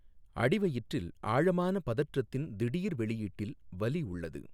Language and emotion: Tamil, neutral